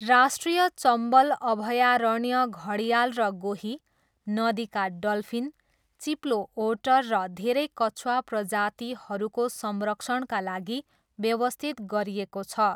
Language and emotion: Nepali, neutral